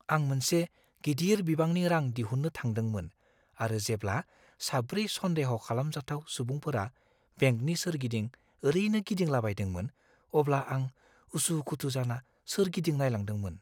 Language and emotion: Bodo, fearful